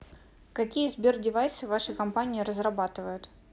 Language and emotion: Russian, neutral